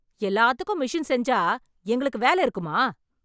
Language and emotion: Tamil, angry